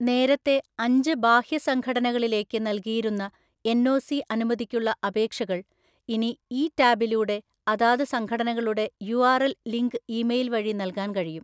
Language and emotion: Malayalam, neutral